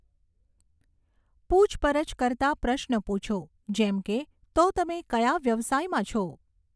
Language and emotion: Gujarati, neutral